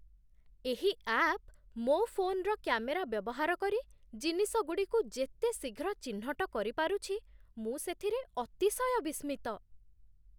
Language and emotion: Odia, surprised